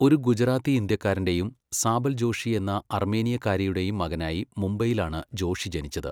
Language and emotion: Malayalam, neutral